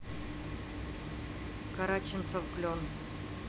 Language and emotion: Russian, neutral